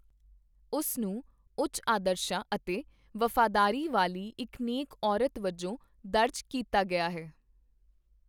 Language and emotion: Punjabi, neutral